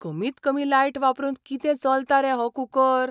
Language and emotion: Goan Konkani, surprised